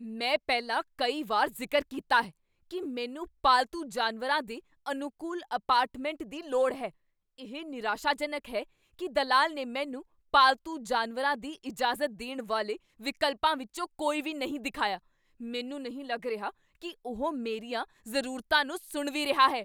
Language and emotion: Punjabi, angry